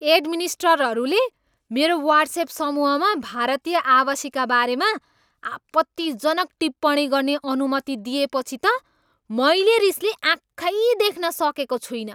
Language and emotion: Nepali, angry